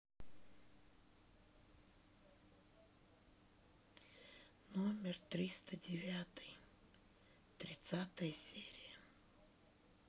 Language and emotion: Russian, sad